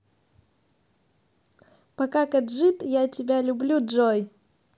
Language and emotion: Russian, positive